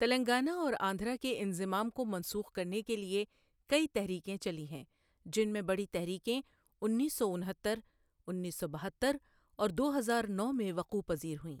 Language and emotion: Urdu, neutral